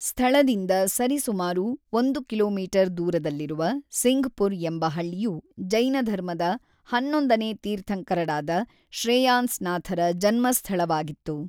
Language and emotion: Kannada, neutral